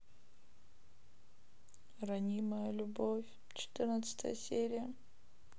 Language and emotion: Russian, sad